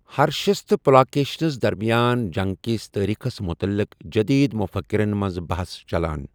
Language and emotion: Kashmiri, neutral